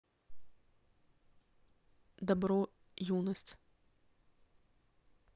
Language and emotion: Russian, neutral